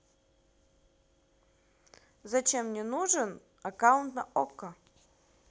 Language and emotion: Russian, neutral